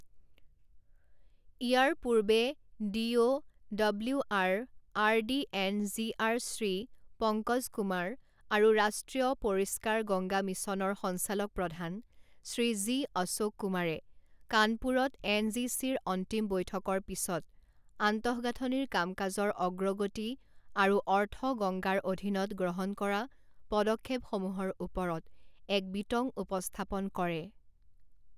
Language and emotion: Assamese, neutral